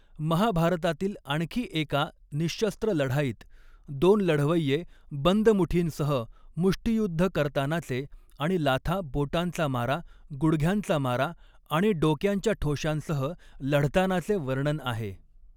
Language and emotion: Marathi, neutral